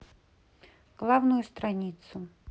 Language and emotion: Russian, neutral